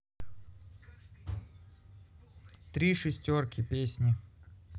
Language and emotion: Russian, neutral